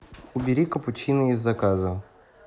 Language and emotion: Russian, neutral